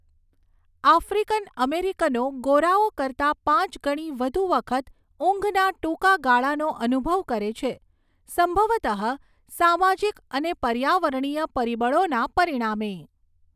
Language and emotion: Gujarati, neutral